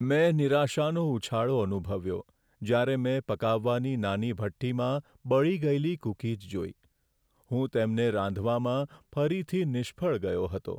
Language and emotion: Gujarati, sad